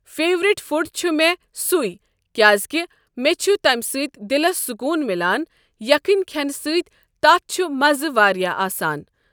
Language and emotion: Kashmiri, neutral